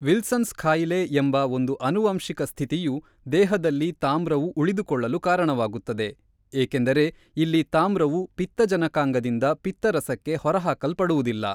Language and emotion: Kannada, neutral